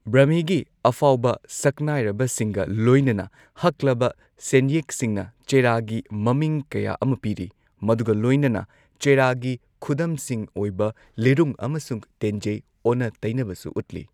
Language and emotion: Manipuri, neutral